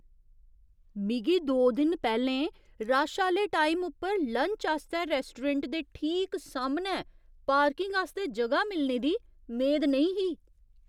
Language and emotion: Dogri, surprised